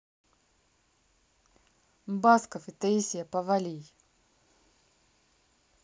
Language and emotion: Russian, neutral